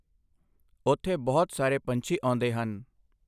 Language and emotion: Punjabi, neutral